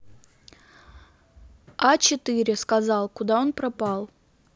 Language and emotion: Russian, neutral